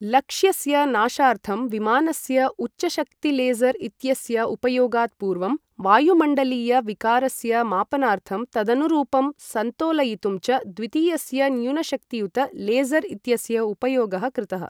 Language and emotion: Sanskrit, neutral